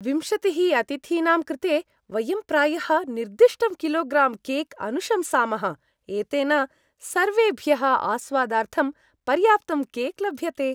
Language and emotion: Sanskrit, happy